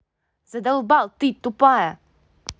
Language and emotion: Russian, angry